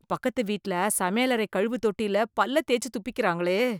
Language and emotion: Tamil, disgusted